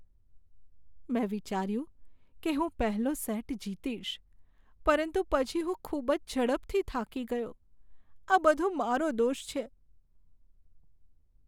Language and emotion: Gujarati, sad